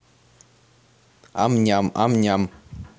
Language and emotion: Russian, positive